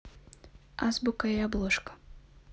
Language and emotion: Russian, neutral